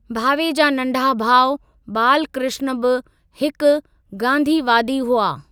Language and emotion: Sindhi, neutral